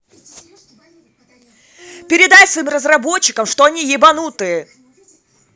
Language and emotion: Russian, angry